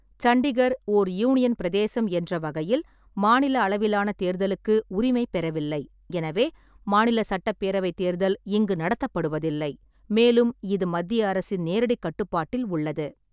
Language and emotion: Tamil, neutral